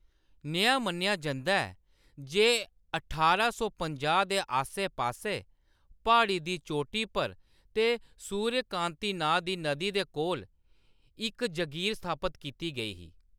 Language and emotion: Dogri, neutral